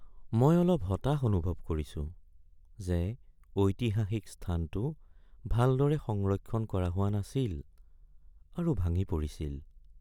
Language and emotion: Assamese, sad